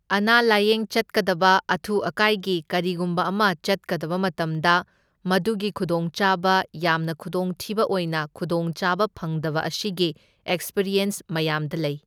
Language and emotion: Manipuri, neutral